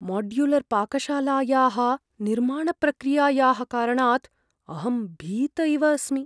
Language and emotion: Sanskrit, fearful